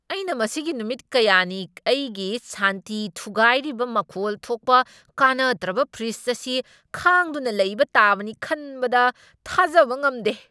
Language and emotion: Manipuri, angry